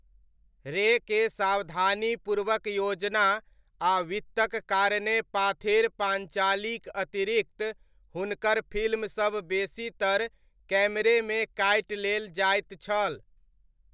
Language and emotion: Maithili, neutral